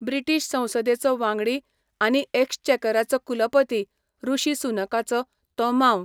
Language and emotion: Goan Konkani, neutral